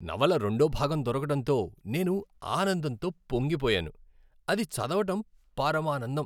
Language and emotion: Telugu, happy